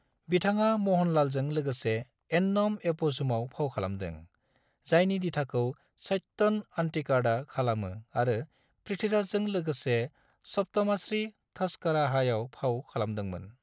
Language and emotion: Bodo, neutral